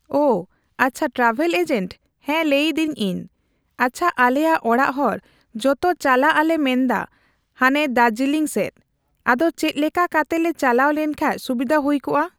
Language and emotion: Santali, neutral